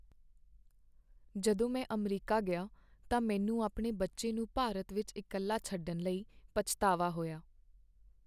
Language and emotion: Punjabi, sad